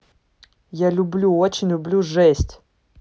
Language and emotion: Russian, angry